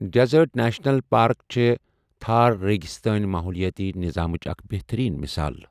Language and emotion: Kashmiri, neutral